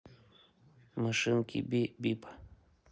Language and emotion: Russian, neutral